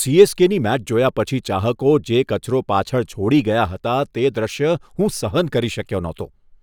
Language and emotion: Gujarati, disgusted